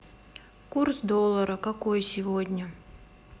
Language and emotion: Russian, sad